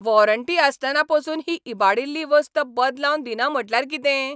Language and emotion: Goan Konkani, angry